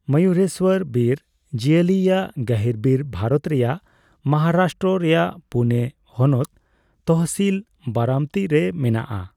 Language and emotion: Santali, neutral